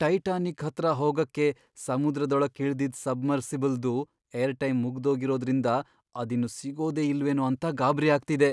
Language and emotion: Kannada, fearful